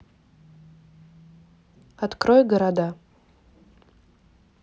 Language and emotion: Russian, neutral